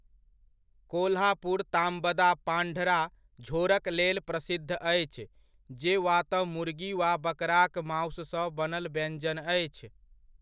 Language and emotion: Maithili, neutral